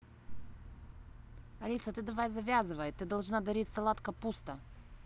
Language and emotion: Russian, angry